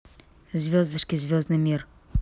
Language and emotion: Russian, neutral